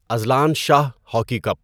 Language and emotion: Urdu, neutral